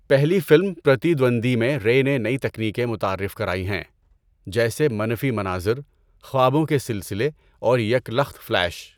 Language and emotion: Urdu, neutral